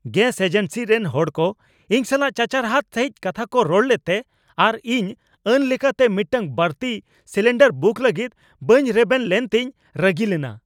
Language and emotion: Santali, angry